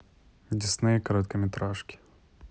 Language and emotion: Russian, neutral